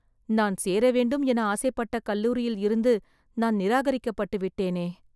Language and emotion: Tamil, sad